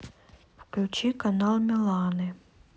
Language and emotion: Russian, neutral